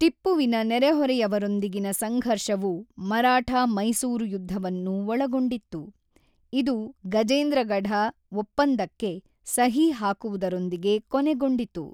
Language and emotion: Kannada, neutral